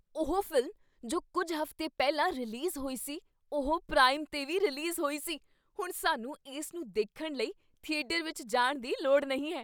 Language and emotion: Punjabi, surprised